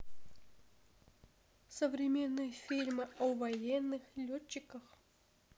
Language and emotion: Russian, sad